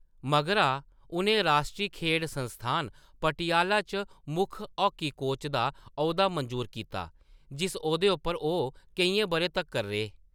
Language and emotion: Dogri, neutral